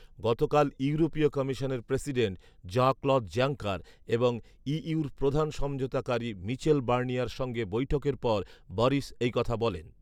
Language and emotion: Bengali, neutral